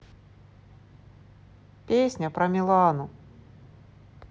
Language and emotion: Russian, neutral